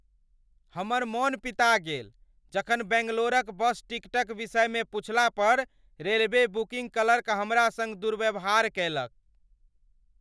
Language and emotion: Maithili, angry